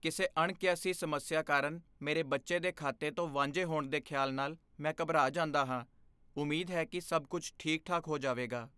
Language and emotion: Punjabi, fearful